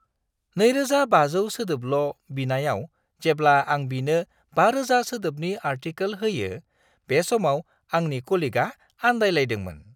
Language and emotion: Bodo, surprised